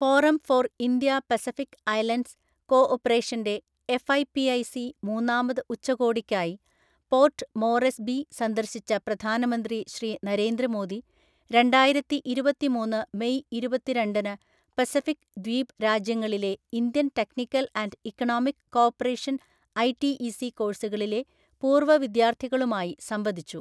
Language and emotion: Malayalam, neutral